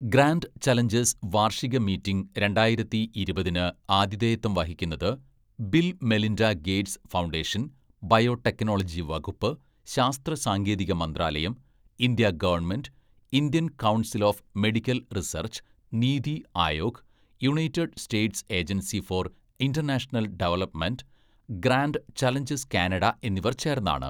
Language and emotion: Malayalam, neutral